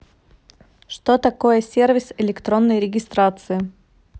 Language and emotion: Russian, neutral